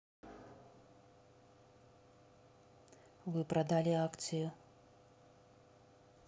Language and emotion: Russian, neutral